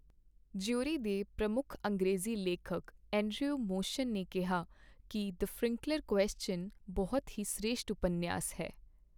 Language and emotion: Punjabi, neutral